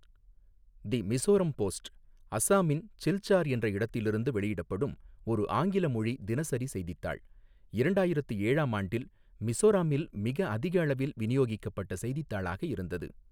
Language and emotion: Tamil, neutral